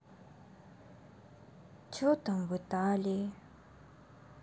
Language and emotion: Russian, sad